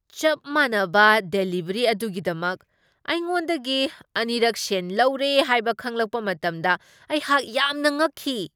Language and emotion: Manipuri, surprised